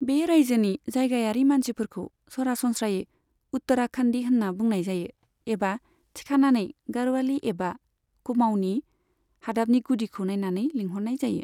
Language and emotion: Bodo, neutral